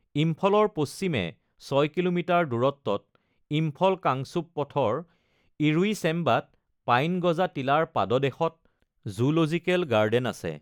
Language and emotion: Assamese, neutral